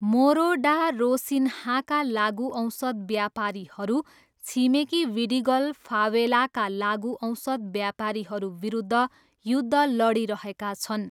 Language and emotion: Nepali, neutral